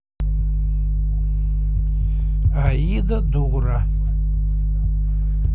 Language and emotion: Russian, neutral